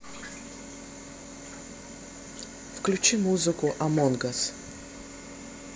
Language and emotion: Russian, neutral